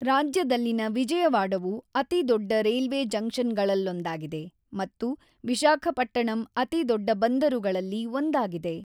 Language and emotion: Kannada, neutral